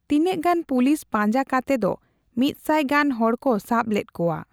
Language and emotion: Santali, neutral